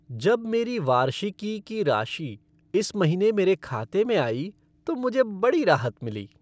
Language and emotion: Hindi, happy